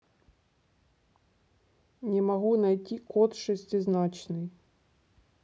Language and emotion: Russian, neutral